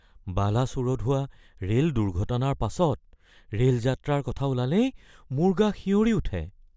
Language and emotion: Assamese, fearful